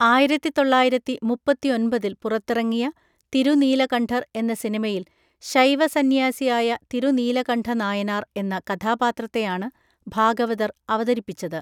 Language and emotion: Malayalam, neutral